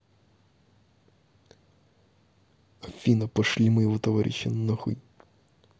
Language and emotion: Russian, angry